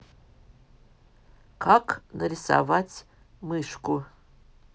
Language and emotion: Russian, neutral